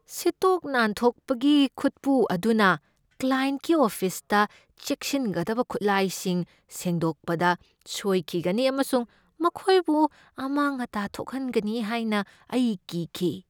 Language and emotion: Manipuri, fearful